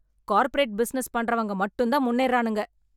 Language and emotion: Tamil, angry